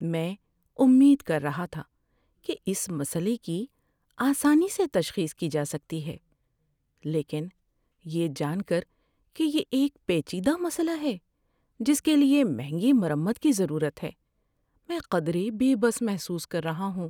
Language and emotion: Urdu, sad